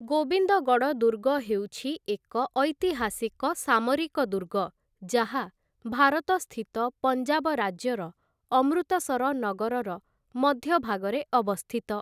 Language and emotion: Odia, neutral